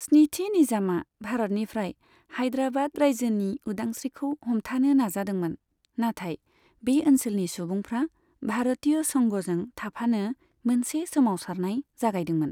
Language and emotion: Bodo, neutral